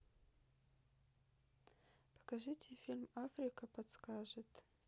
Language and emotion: Russian, neutral